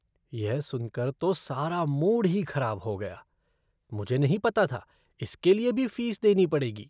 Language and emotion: Hindi, disgusted